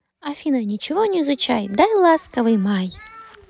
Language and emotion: Russian, positive